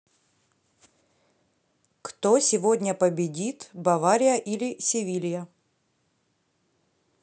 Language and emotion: Russian, neutral